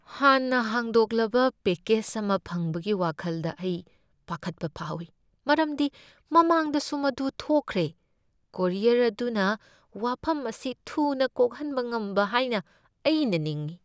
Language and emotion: Manipuri, fearful